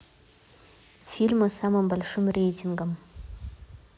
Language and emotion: Russian, neutral